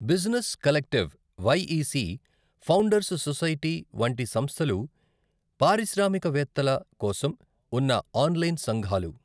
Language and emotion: Telugu, neutral